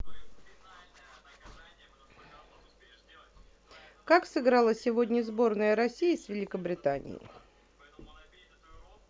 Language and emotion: Russian, neutral